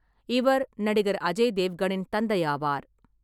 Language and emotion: Tamil, neutral